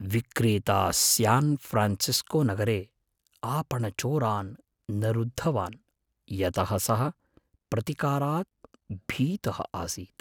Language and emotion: Sanskrit, fearful